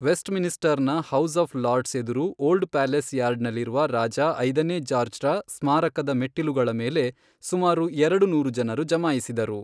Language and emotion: Kannada, neutral